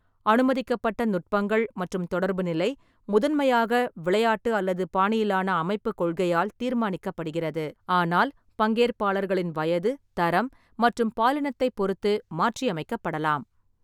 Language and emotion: Tamil, neutral